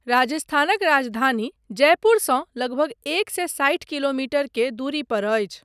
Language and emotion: Maithili, neutral